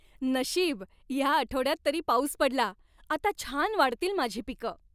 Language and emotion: Marathi, happy